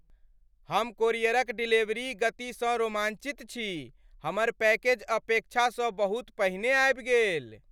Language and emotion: Maithili, happy